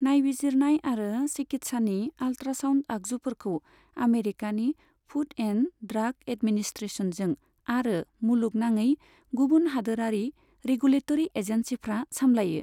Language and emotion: Bodo, neutral